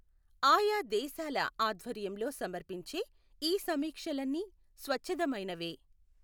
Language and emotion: Telugu, neutral